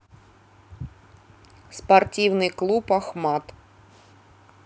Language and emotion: Russian, neutral